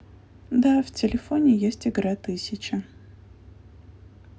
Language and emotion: Russian, neutral